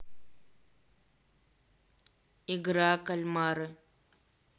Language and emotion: Russian, neutral